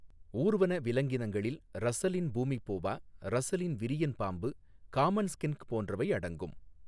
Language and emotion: Tamil, neutral